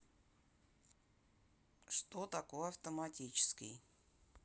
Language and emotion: Russian, neutral